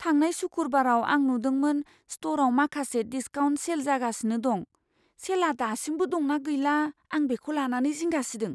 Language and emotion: Bodo, fearful